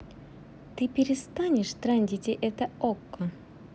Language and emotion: Russian, angry